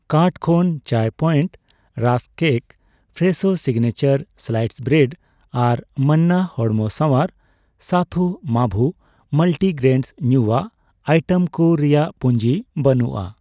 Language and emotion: Santali, neutral